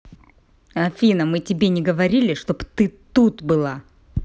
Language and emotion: Russian, angry